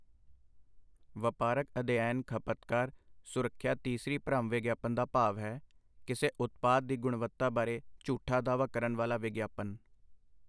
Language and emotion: Punjabi, neutral